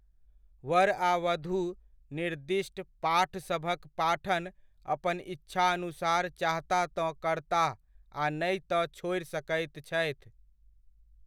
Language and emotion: Maithili, neutral